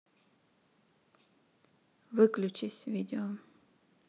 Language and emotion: Russian, neutral